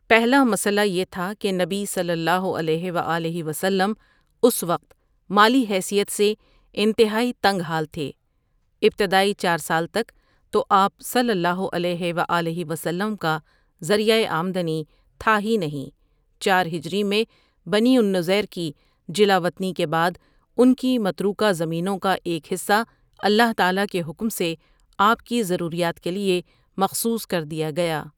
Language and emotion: Urdu, neutral